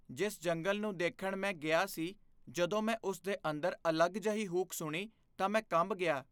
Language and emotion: Punjabi, fearful